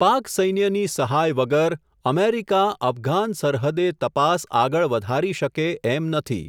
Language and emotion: Gujarati, neutral